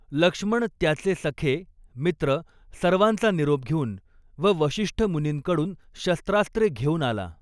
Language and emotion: Marathi, neutral